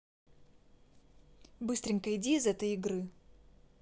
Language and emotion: Russian, neutral